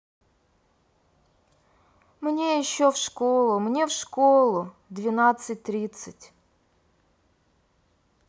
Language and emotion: Russian, sad